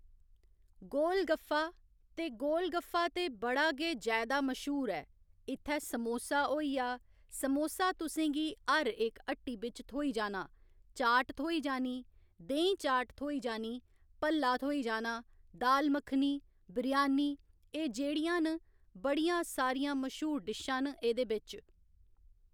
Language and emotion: Dogri, neutral